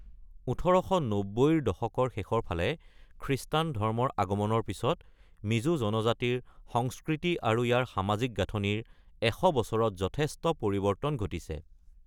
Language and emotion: Assamese, neutral